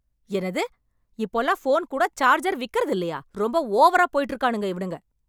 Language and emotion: Tamil, angry